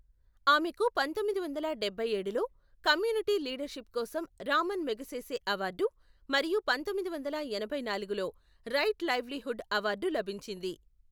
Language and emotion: Telugu, neutral